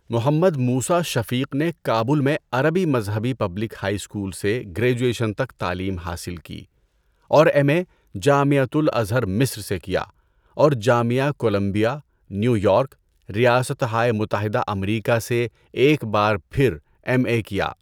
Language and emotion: Urdu, neutral